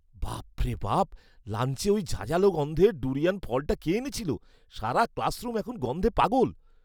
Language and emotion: Bengali, disgusted